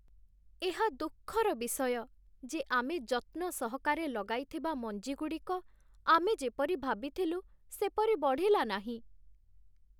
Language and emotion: Odia, sad